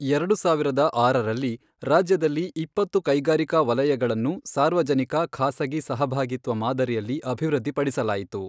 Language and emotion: Kannada, neutral